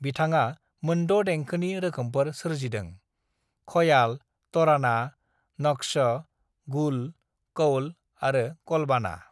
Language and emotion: Bodo, neutral